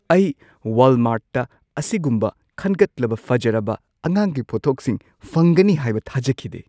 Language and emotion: Manipuri, surprised